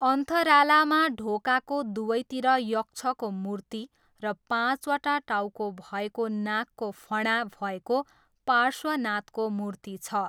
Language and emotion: Nepali, neutral